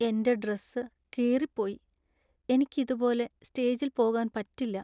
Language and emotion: Malayalam, sad